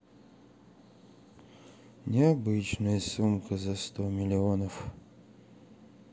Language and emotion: Russian, sad